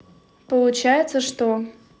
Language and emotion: Russian, neutral